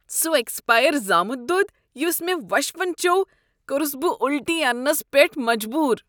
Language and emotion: Kashmiri, disgusted